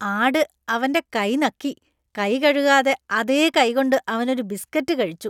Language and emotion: Malayalam, disgusted